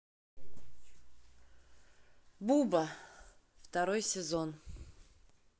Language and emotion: Russian, neutral